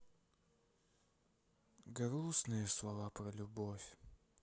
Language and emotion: Russian, sad